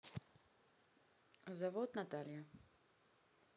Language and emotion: Russian, neutral